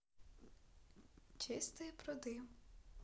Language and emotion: Russian, neutral